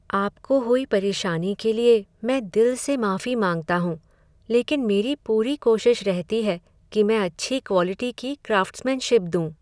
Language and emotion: Hindi, sad